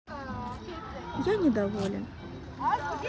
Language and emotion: Russian, neutral